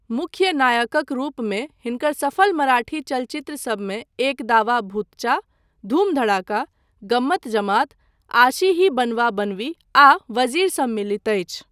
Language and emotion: Maithili, neutral